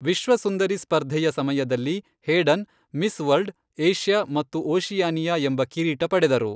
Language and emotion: Kannada, neutral